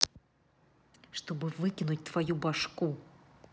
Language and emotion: Russian, angry